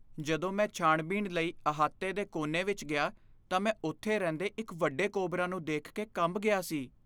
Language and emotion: Punjabi, fearful